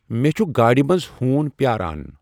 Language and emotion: Kashmiri, neutral